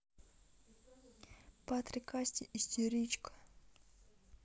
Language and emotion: Russian, neutral